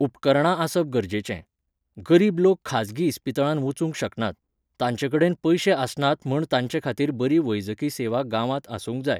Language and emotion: Goan Konkani, neutral